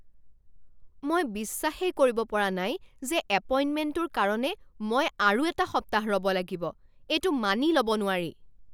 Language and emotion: Assamese, angry